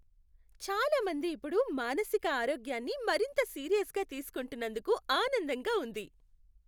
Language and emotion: Telugu, happy